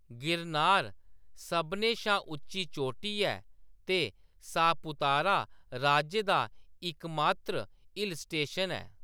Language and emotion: Dogri, neutral